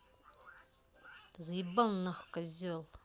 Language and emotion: Russian, angry